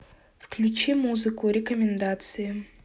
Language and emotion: Russian, neutral